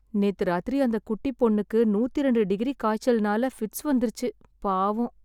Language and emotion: Tamil, sad